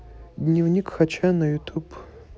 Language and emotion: Russian, neutral